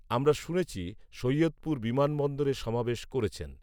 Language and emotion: Bengali, neutral